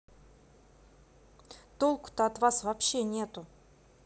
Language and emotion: Russian, angry